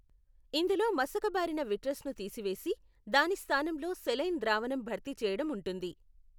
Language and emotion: Telugu, neutral